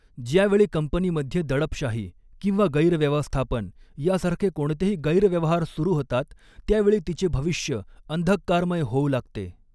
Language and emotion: Marathi, neutral